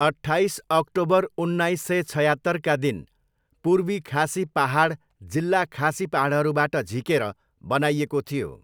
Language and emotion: Nepali, neutral